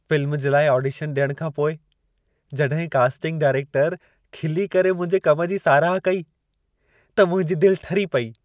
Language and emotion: Sindhi, happy